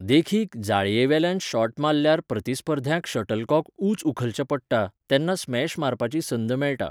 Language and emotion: Goan Konkani, neutral